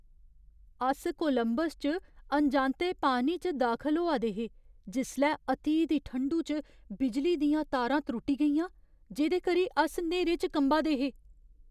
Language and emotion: Dogri, fearful